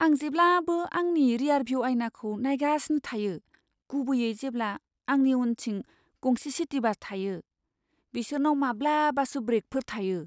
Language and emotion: Bodo, fearful